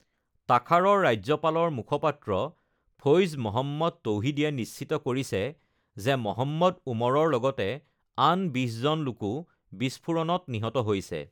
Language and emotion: Assamese, neutral